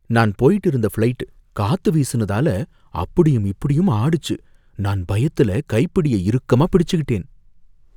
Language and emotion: Tamil, fearful